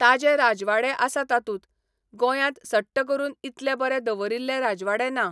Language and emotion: Goan Konkani, neutral